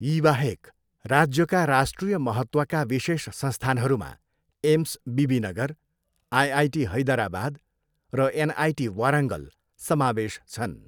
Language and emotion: Nepali, neutral